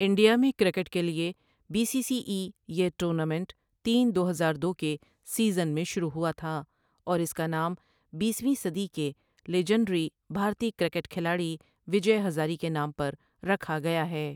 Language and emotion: Urdu, neutral